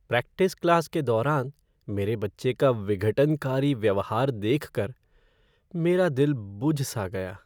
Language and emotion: Hindi, sad